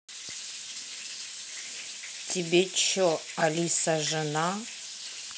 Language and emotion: Russian, angry